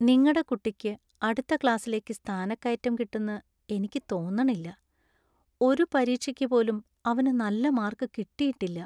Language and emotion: Malayalam, sad